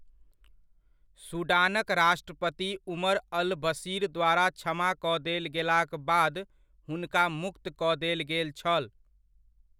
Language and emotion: Maithili, neutral